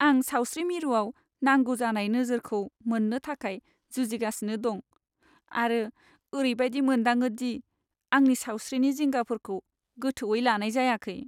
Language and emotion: Bodo, sad